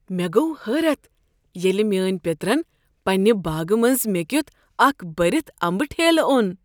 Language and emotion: Kashmiri, surprised